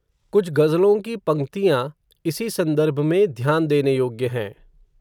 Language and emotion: Hindi, neutral